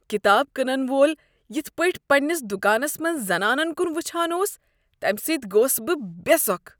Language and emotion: Kashmiri, disgusted